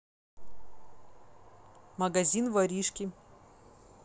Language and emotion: Russian, neutral